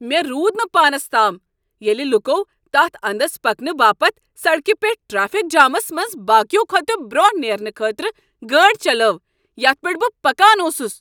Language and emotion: Kashmiri, angry